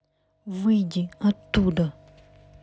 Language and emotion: Russian, angry